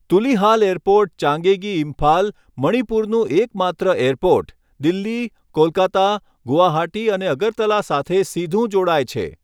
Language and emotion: Gujarati, neutral